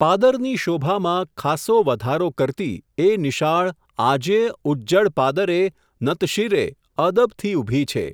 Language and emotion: Gujarati, neutral